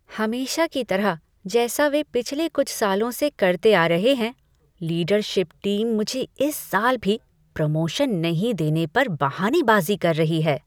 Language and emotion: Hindi, disgusted